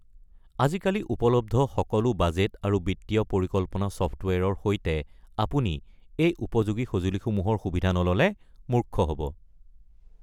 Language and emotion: Assamese, neutral